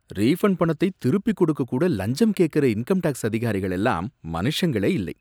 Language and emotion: Tamil, disgusted